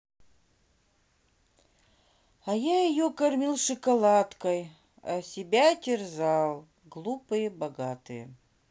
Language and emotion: Russian, sad